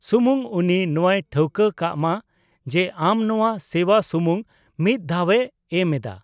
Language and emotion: Santali, neutral